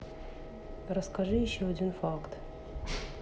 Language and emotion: Russian, neutral